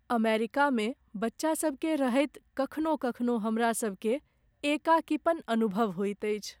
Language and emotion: Maithili, sad